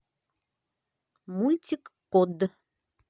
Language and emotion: Russian, positive